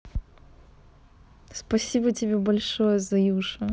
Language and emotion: Russian, positive